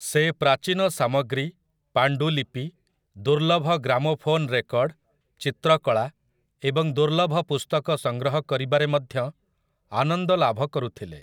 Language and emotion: Odia, neutral